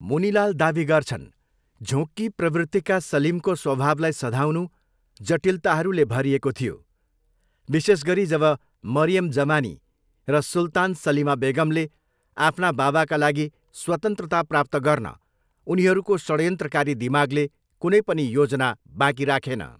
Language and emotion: Nepali, neutral